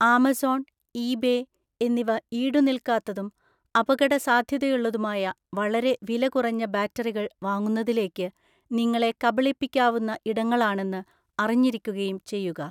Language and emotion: Malayalam, neutral